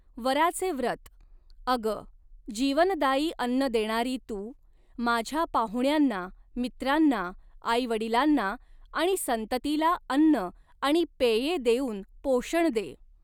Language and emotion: Marathi, neutral